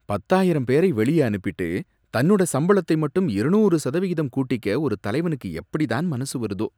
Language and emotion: Tamil, disgusted